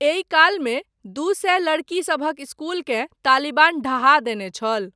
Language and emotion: Maithili, neutral